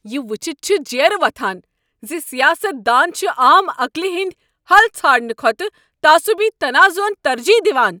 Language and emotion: Kashmiri, angry